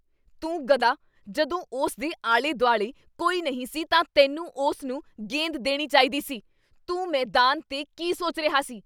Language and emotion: Punjabi, angry